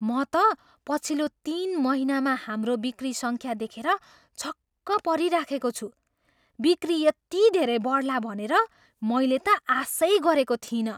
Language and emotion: Nepali, surprised